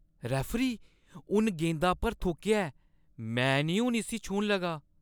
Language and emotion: Dogri, disgusted